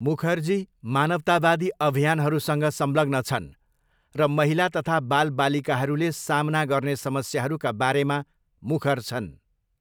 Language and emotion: Nepali, neutral